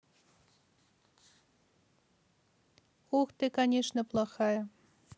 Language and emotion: Russian, neutral